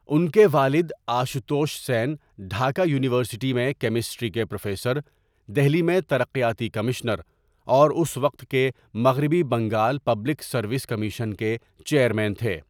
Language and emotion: Urdu, neutral